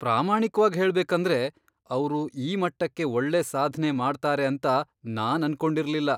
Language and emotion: Kannada, surprised